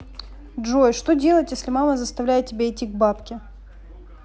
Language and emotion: Russian, neutral